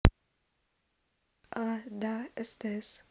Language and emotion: Russian, neutral